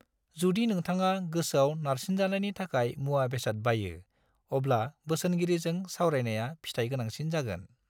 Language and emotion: Bodo, neutral